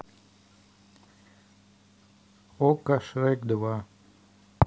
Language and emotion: Russian, neutral